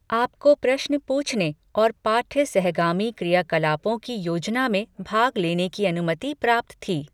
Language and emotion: Hindi, neutral